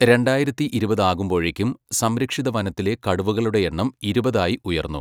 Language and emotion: Malayalam, neutral